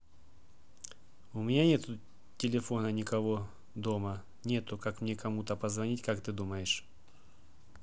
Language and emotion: Russian, neutral